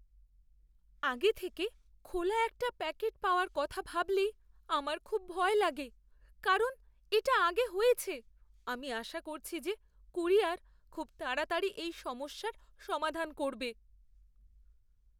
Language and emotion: Bengali, fearful